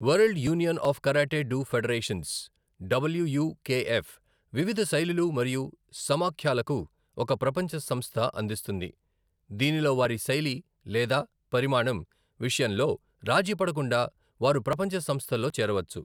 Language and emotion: Telugu, neutral